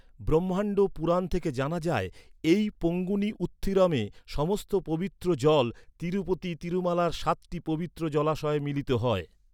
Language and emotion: Bengali, neutral